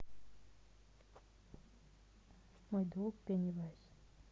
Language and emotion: Russian, neutral